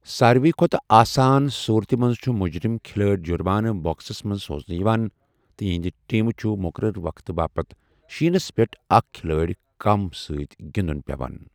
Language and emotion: Kashmiri, neutral